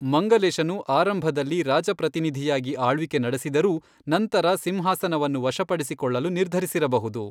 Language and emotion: Kannada, neutral